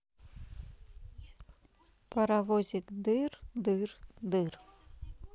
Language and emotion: Russian, neutral